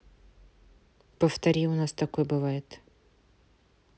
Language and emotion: Russian, neutral